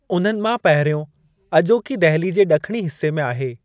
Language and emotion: Sindhi, neutral